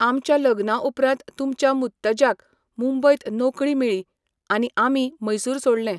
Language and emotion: Goan Konkani, neutral